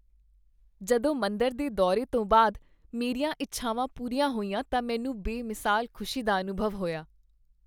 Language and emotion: Punjabi, happy